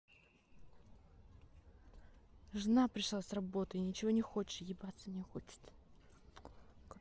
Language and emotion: Russian, angry